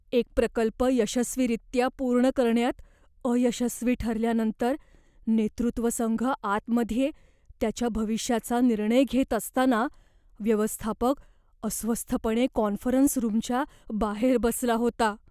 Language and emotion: Marathi, fearful